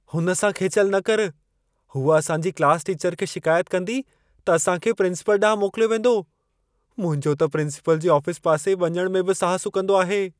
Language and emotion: Sindhi, fearful